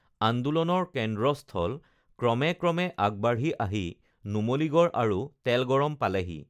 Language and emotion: Assamese, neutral